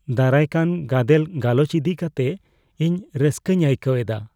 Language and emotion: Santali, fearful